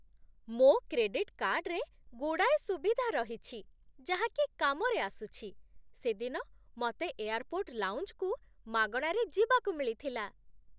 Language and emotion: Odia, happy